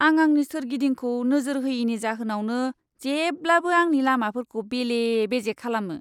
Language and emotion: Bodo, disgusted